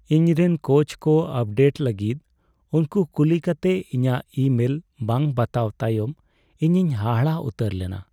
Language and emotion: Santali, sad